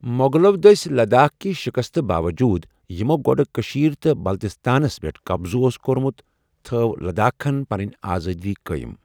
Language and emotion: Kashmiri, neutral